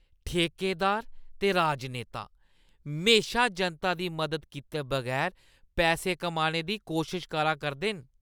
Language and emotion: Dogri, disgusted